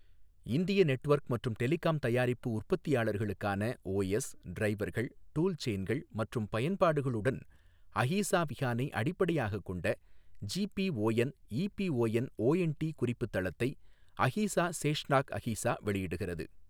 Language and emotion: Tamil, neutral